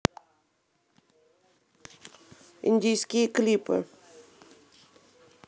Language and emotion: Russian, neutral